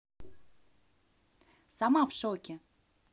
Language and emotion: Russian, neutral